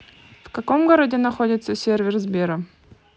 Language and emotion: Russian, neutral